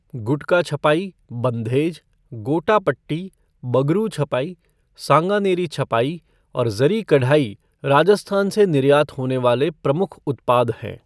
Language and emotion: Hindi, neutral